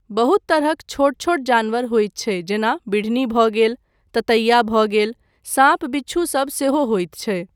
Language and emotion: Maithili, neutral